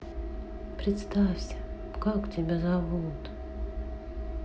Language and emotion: Russian, sad